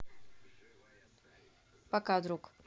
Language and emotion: Russian, neutral